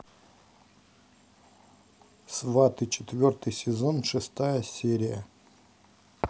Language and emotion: Russian, neutral